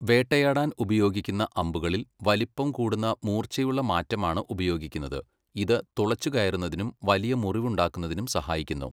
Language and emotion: Malayalam, neutral